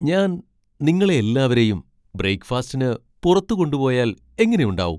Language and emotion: Malayalam, surprised